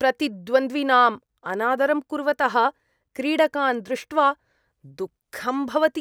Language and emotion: Sanskrit, disgusted